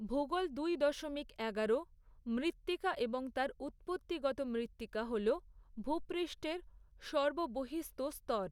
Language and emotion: Bengali, neutral